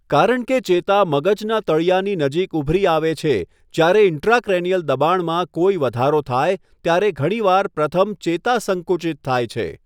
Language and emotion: Gujarati, neutral